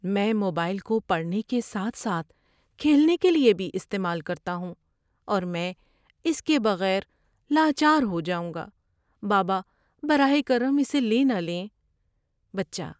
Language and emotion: Urdu, sad